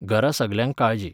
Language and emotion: Goan Konkani, neutral